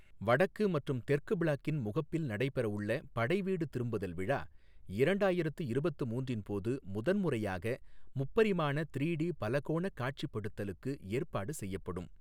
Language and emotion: Tamil, neutral